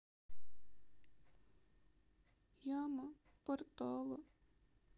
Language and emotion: Russian, sad